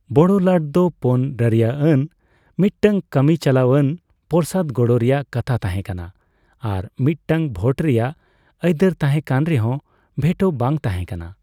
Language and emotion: Santali, neutral